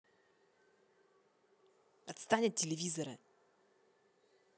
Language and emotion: Russian, angry